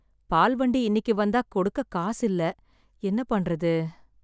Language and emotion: Tamil, sad